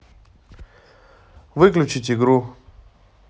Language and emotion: Russian, neutral